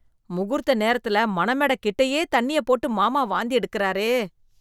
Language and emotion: Tamil, disgusted